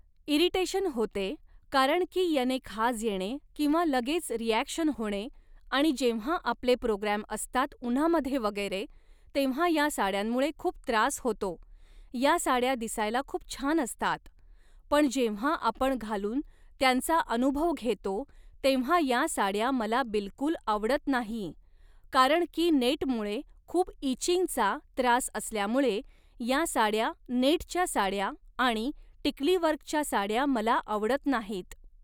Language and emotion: Marathi, neutral